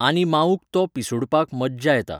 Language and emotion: Goan Konkani, neutral